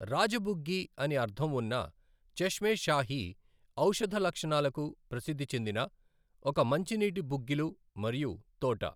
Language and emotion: Telugu, neutral